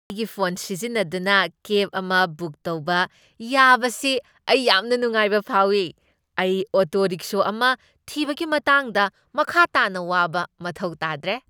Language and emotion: Manipuri, happy